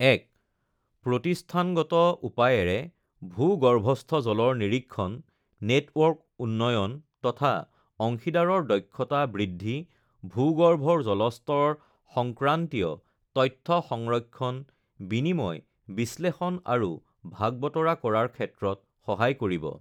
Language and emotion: Assamese, neutral